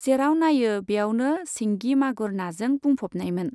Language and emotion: Bodo, neutral